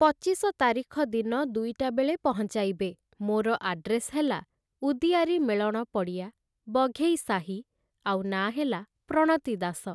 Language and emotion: Odia, neutral